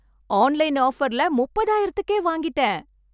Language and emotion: Tamil, happy